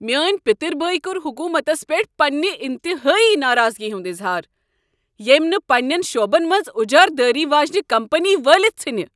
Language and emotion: Kashmiri, angry